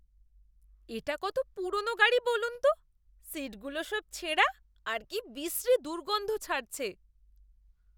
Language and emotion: Bengali, disgusted